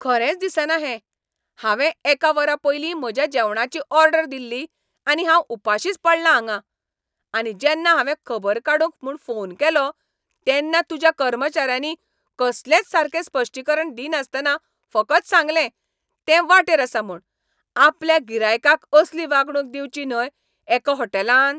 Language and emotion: Goan Konkani, angry